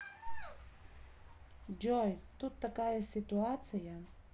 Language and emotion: Russian, neutral